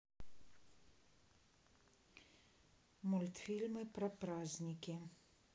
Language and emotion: Russian, neutral